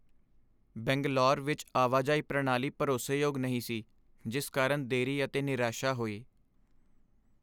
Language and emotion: Punjabi, sad